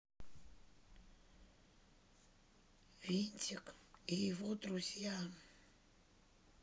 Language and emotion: Russian, sad